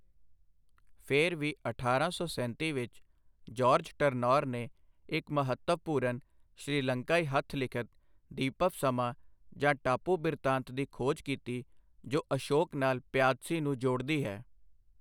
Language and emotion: Punjabi, neutral